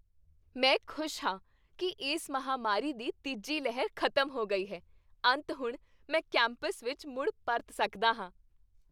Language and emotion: Punjabi, happy